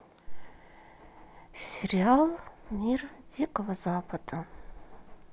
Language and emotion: Russian, sad